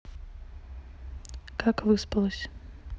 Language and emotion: Russian, neutral